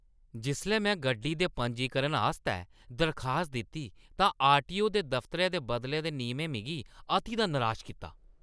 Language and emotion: Dogri, angry